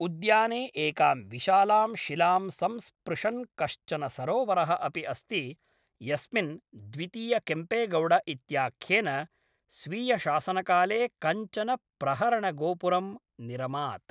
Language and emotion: Sanskrit, neutral